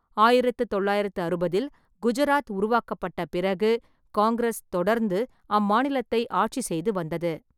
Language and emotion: Tamil, neutral